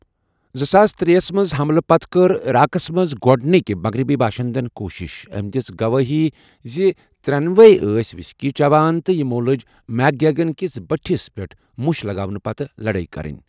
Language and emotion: Kashmiri, neutral